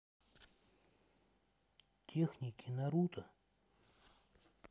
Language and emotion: Russian, neutral